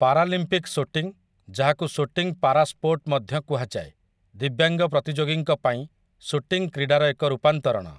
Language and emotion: Odia, neutral